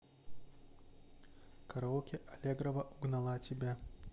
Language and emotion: Russian, neutral